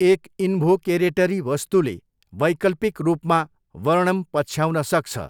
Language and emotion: Nepali, neutral